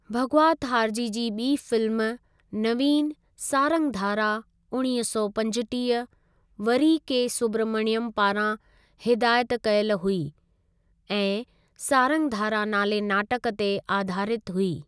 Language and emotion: Sindhi, neutral